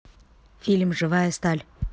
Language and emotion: Russian, neutral